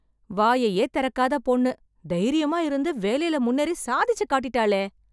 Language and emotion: Tamil, surprised